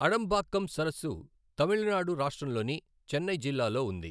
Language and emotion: Telugu, neutral